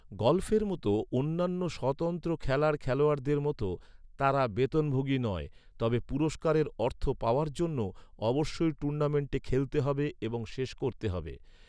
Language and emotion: Bengali, neutral